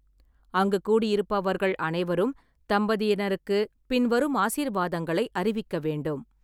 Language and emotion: Tamil, neutral